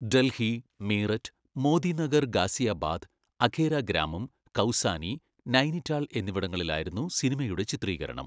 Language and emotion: Malayalam, neutral